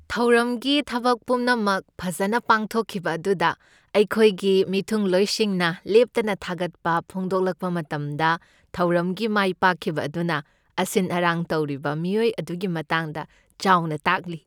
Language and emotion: Manipuri, happy